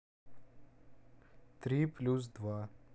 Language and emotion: Russian, neutral